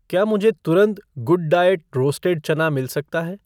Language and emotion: Hindi, neutral